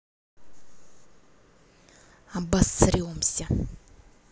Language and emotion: Russian, angry